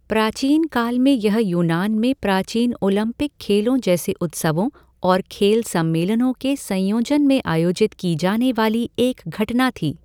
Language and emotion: Hindi, neutral